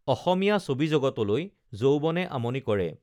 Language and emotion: Assamese, neutral